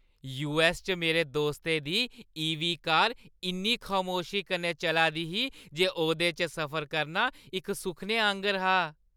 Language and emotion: Dogri, happy